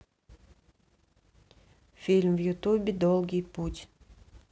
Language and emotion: Russian, neutral